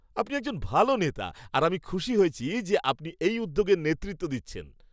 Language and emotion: Bengali, happy